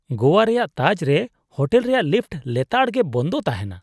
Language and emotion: Santali, disgusted